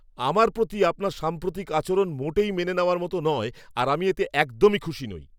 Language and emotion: Bengali, angry